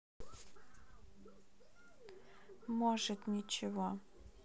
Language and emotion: Russian, neutral